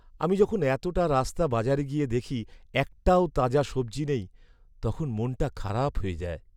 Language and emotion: Bengali, sad